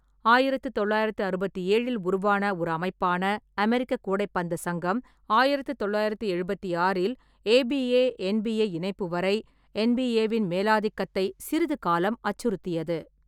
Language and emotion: Tamil, neutral